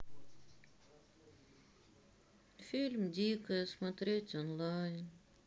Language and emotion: Russian, sad